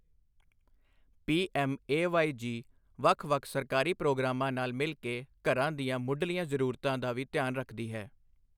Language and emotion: Punjabi, neutral